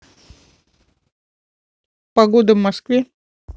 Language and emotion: Russian, neutral